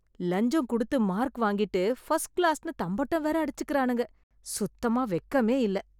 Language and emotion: Tamil, disgusted